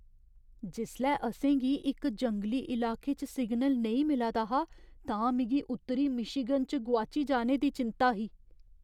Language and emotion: Dogri, fearful